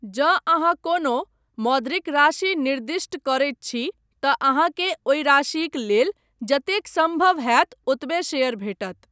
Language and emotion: Maithili, neutral